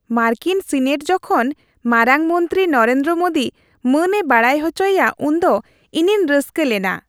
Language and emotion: Santali, happy